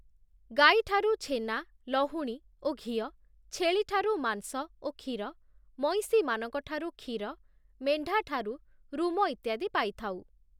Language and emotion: Odia, neutral